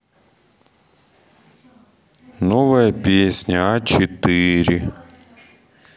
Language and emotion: Russian, sad